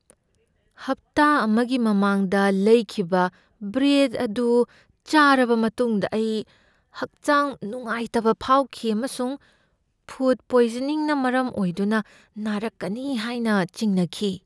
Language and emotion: Manipuri, fearful